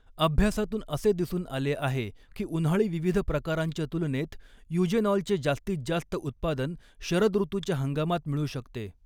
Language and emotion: Marathi, neutral